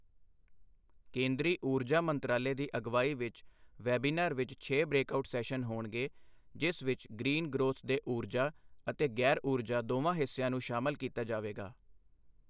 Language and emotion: Punjabi, neutral